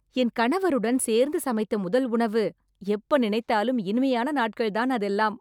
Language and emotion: Tamil, happy